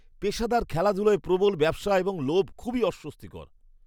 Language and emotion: Bengali, disgusted